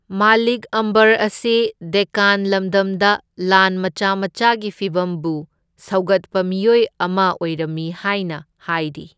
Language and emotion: Manipuri, neutral